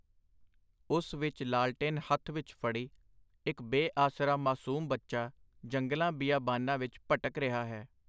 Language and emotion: Punjabi, neutral